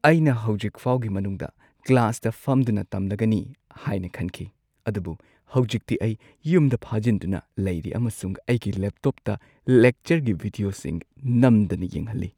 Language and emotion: Manipuri, sad